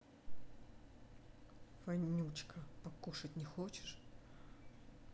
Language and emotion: Russian, angry